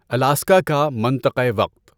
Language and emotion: Urdu, neutral